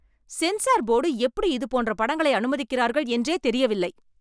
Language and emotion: Tamil, angry